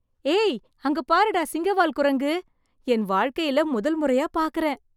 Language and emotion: Tamil, surprised